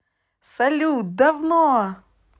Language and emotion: Russian, positive